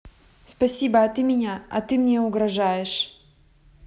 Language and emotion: Russian, neutral